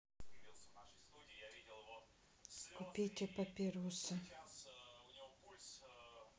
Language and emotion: Russian, sad